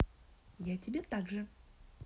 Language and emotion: Russian, positive